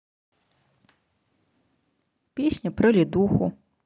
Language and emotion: Russian, neutral